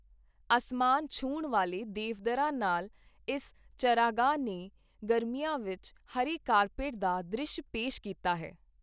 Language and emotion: Punjabi, neutral